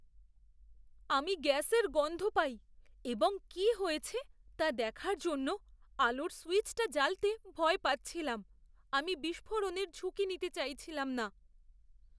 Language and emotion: Bengali, fearful